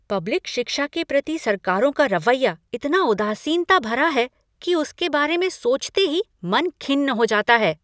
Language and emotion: Hindi, angry